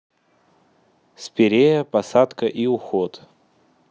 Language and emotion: Russian, neutral